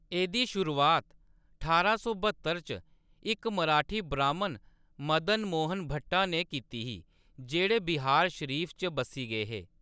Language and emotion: Dogri, neutral